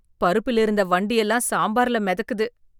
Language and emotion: Tamil, disgusted